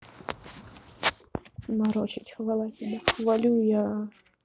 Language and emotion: Russian, neutral